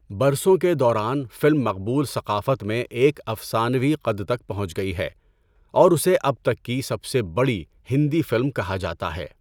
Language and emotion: Urdu, neutral